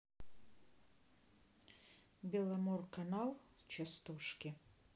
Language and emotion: Russian, neutral